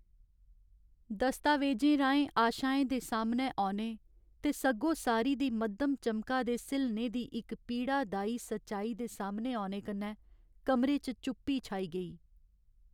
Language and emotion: Dogri, sad